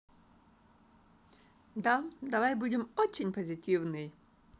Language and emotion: Russian, positive